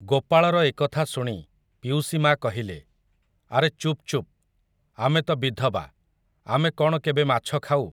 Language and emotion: Odia, neutral